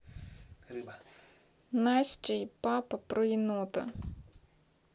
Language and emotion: Russian, neutral